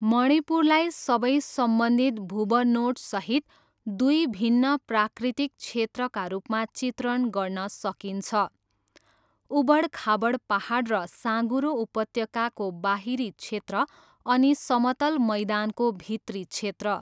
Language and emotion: Nepali, neutral